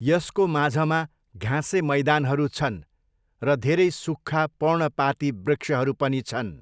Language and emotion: Nepali, neutral